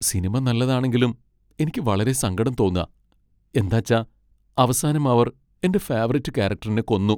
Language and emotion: Malayalam, sad